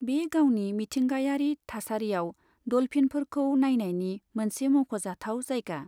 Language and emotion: Bodo, neutral